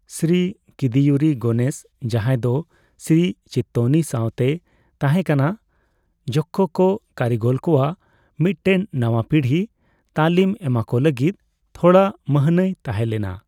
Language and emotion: Santali, neutral